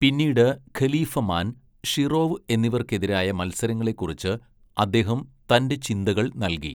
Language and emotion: Malayalam, neutral